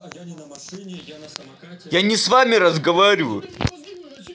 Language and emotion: Russian, angry